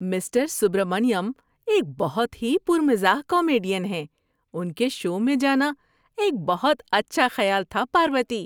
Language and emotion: Urdu, happy